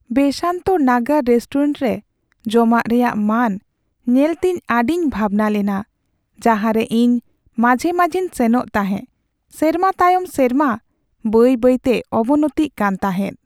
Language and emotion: Santali, sad